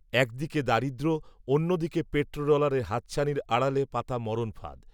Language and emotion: Bengali, neutral